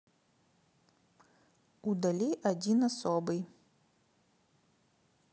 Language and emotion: Russian, neutral